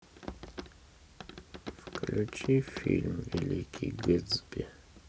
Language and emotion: Russian, sad